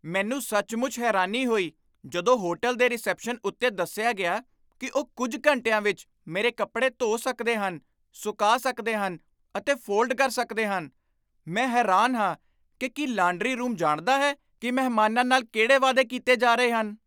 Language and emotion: Punjabi, surprised